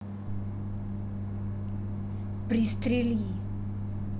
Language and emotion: Russian, angry